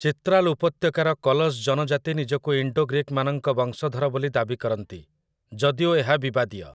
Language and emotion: Odia, neutral